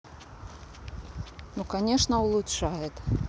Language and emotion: Russian, neutral